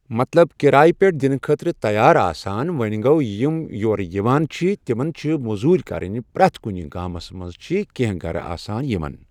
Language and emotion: Kashmiri, neutral